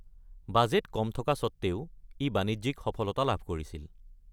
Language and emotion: Assamese, neutral